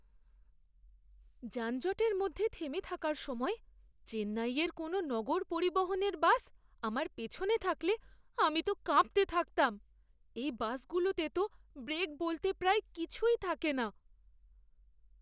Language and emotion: Bengali, fearful